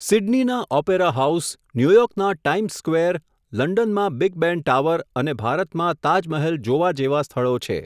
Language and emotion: Gujarati, neutral